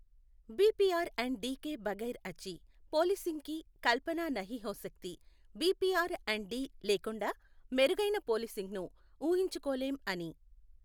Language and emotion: Telugu, neutral